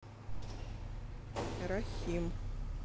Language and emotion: Russian, neutral